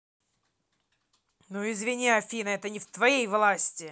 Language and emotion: Russian, angry